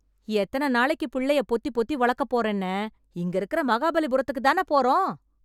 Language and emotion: Tamil, angry